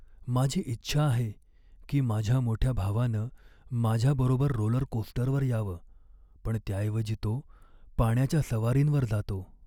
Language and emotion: Marathi, sad